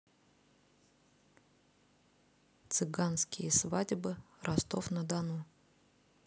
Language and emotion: Russian, neutral